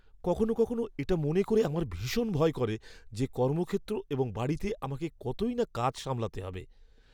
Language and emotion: Bengali, fearful